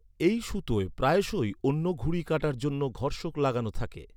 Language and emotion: Bengali, neutral